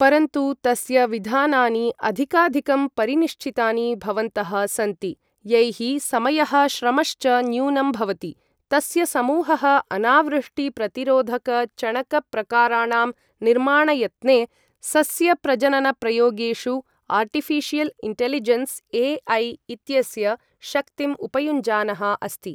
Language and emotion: Sanskrit, neutral